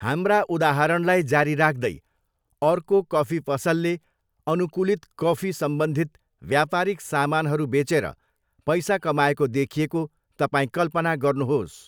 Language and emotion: Nepali, neutral